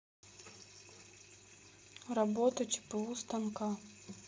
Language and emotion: Russian, sad